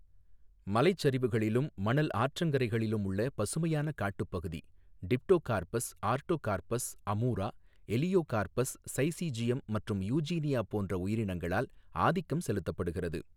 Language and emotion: Tamil, neutral